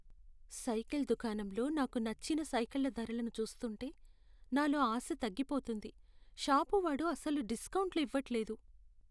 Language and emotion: Telugu, sad